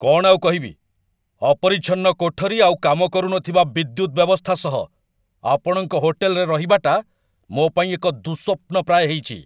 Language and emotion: Odia, angry